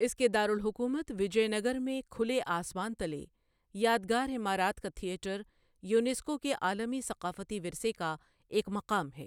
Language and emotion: Urdu, neutral